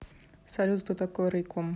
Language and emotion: Russian, neutral